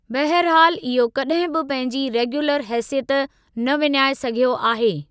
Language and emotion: Sindhi, neutral